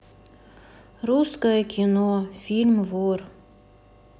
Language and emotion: Russian, sad